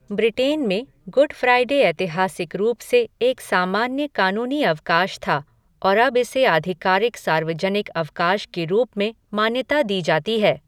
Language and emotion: Hindi, neutral